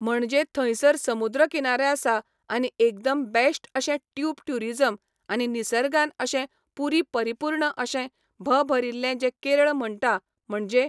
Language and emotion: Goan Konkani, neutral